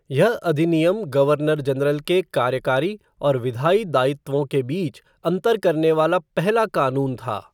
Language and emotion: Hindi, neutral